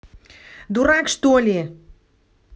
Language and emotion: Russian, angry